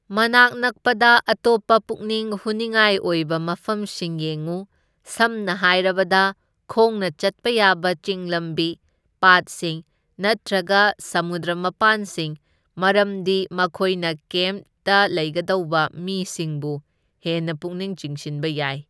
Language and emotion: Manipuri, neutral